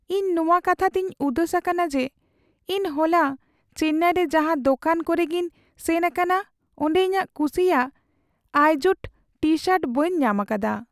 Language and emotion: Santali, sad